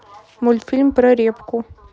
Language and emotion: Russian, neutral